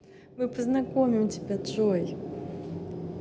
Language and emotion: Russian, positive